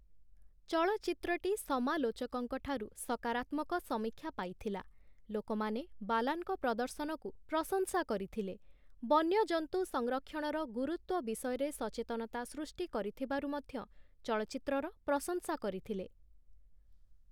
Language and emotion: Odia, neutral